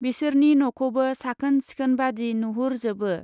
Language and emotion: Bodo, neutral